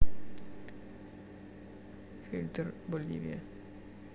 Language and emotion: Russian, neutral